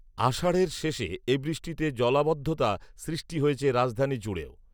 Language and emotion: Bengali, neutral